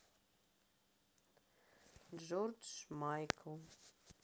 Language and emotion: Russian, sad